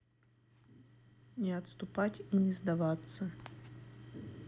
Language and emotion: Russian, neutral